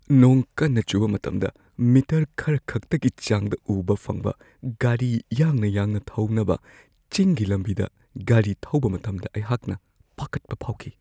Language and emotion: Manipuri, fearful